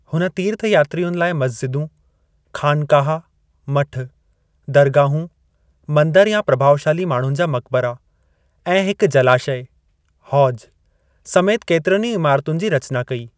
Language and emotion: Sindhi, neutral